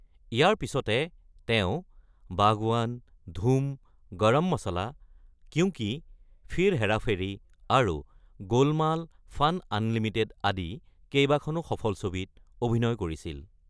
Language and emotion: Assamese, neutral